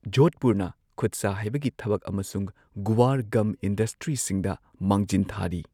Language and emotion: Manipuri, neutral